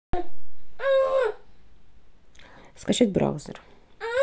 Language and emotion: Russian, neutral